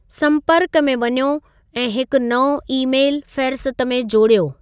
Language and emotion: Sindhi, neutral